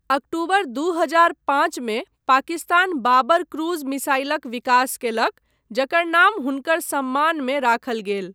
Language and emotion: Maithili, neutral